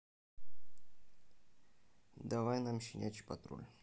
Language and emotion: Russian, neutral